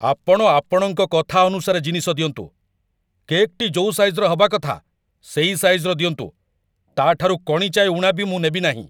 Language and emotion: Odia, angry